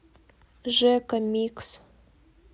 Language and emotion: Russian, neutral